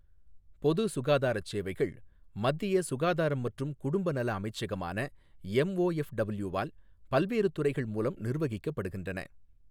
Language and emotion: Tamil, neutral